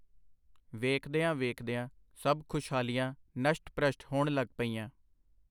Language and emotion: Punjabi, neutral